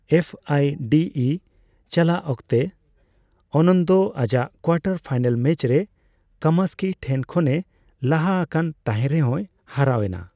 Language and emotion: Santali, neutral